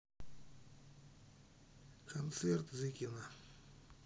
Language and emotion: Russian, neutral